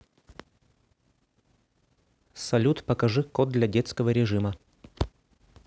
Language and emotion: Russian, neutral